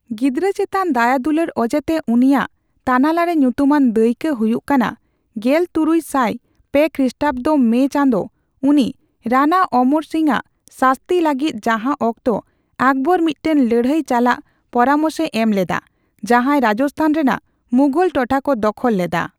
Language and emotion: Santali, neutral